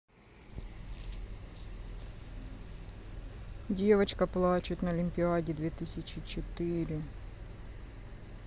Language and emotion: Russian, sad